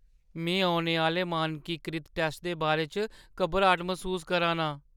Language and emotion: Dogri, fearful